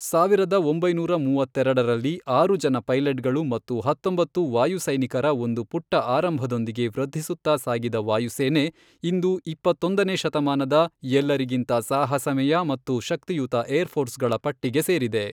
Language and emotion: Kannada, neutral